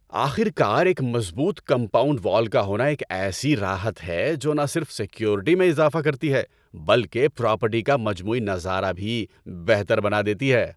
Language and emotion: Urdu, happy